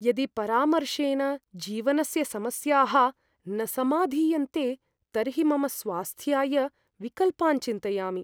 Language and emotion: Sanskrit, fearful